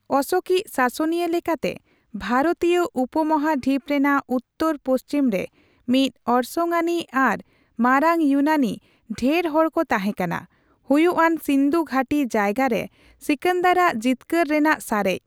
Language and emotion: Santali, neutral